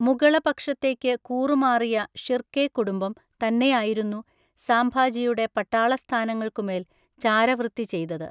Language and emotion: Malayalam, neutral